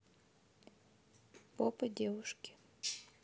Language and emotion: Russian, neutral